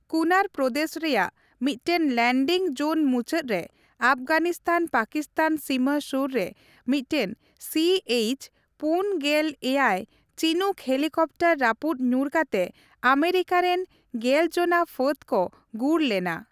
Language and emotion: Santali, neutral